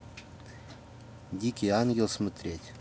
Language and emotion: Russian, neutral